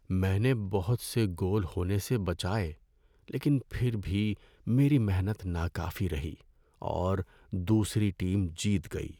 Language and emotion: Urdu, sad